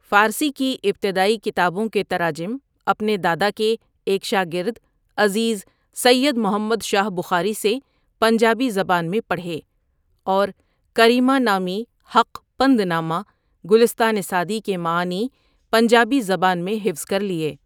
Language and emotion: Urdu, neutral